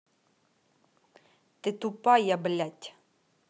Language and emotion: Russian, angry